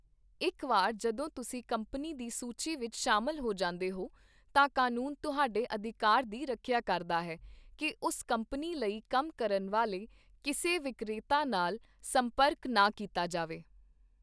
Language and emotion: Punjabi, neutral